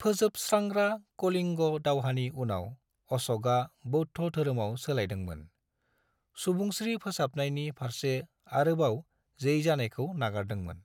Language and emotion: Bodo, neutral